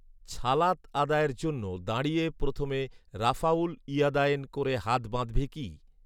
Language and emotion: Bengali, neutral